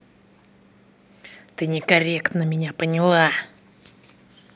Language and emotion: Russian, angry